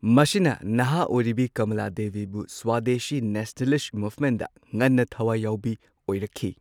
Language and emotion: Manipuri, neutral